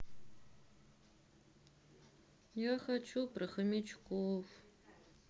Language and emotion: Russian, sad